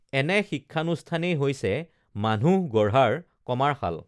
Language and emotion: Assamese, neutral